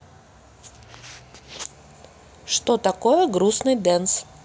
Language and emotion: Russian, neutral